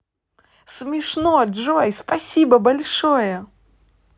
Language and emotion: Russian, positive